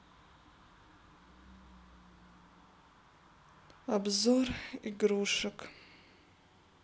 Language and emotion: Russian, sad